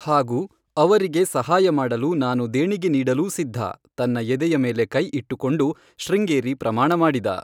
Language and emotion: Kannada, neutral